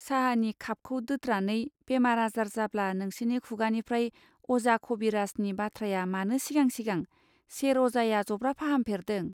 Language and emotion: Bodo, neutral